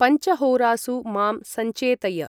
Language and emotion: Sanskrit, neutral